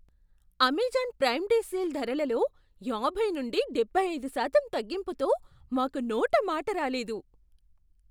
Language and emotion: Telugu, surprised